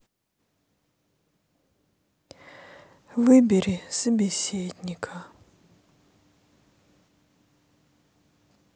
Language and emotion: Russian, sad